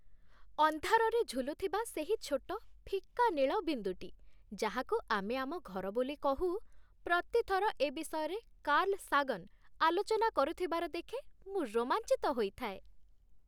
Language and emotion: Odia, happy